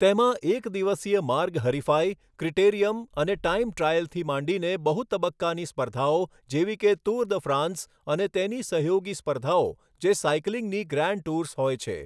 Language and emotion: Gujarati, neutral